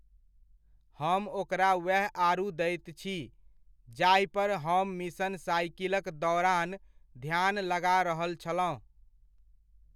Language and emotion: Maithili, neutral